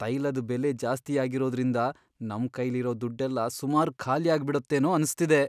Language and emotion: Kannada, fearful